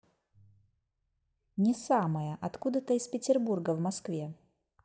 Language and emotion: Russian, neutral